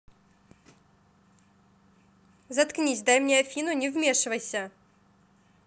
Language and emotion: Russian, angry